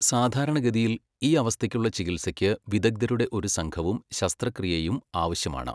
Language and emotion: Malayalam, neutral